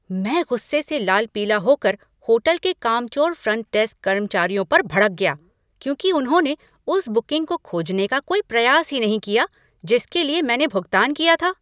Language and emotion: Hindi, angry